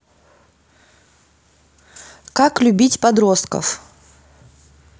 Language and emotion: Russian, neutral